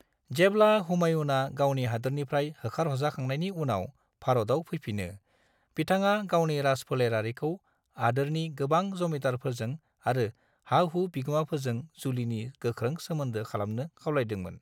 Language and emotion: Bodo, neutral